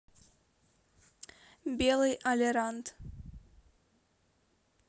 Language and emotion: Russian, neutral